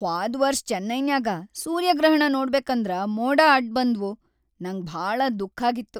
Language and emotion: Kannada, sad